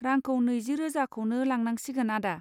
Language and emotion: Bodo, neutral